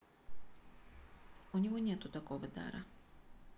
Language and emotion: Russian, neutral